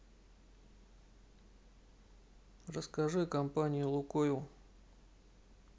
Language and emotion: Russian, neutral